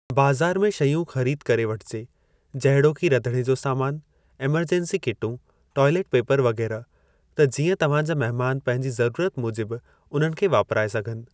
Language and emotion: Sindhi, neutral